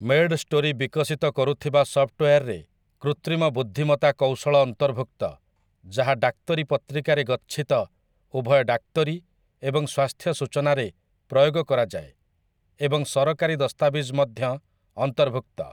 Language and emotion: Odia, neutral